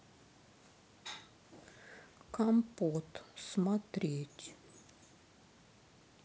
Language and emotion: Russian, sad